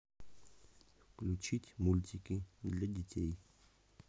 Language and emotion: Russian, neutral